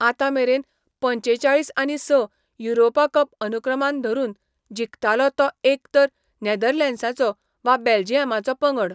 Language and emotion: Goan Konkani, neutral